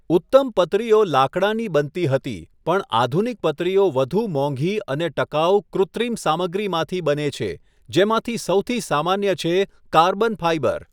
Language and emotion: Gujarati, neutral